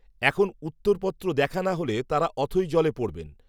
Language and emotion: Bengali, neutral